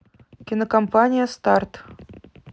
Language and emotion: Russian, neutral